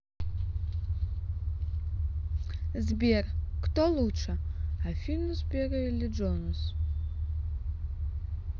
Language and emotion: Russian, neutral